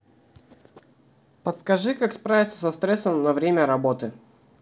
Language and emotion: Russian, neutral